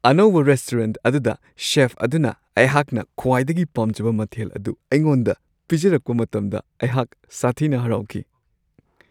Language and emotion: Manipuri, happy